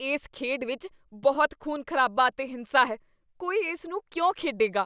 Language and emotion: Punjabi, disgusted